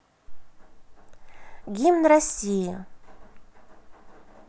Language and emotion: Russian, positive